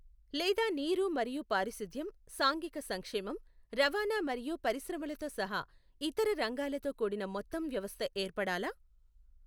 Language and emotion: Telugu, neutral